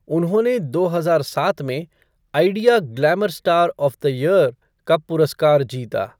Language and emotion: Hindi, neutral